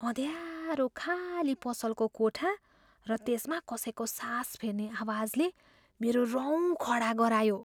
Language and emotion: Nepali, fearful